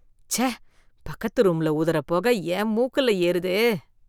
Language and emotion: Tamil, disgusted